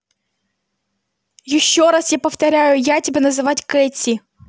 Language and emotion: Russian, angry